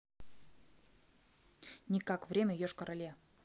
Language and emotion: Russian, neutral